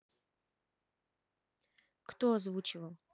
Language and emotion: Russian, neutral